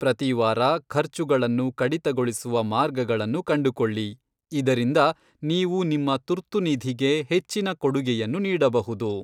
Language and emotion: Kannada, neutral